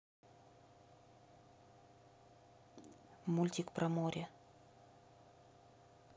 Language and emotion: Russian, neutral